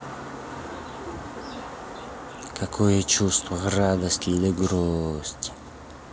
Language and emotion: Russian, neutral